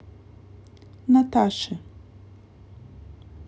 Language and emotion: Russian, neutral